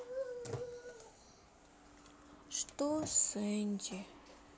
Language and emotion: Russian, sad